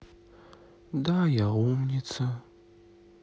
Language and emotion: Russian, sad